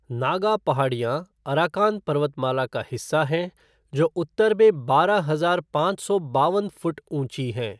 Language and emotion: Hindi, neutral